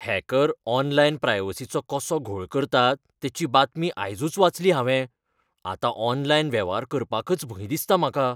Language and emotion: Goan Konkani, fearful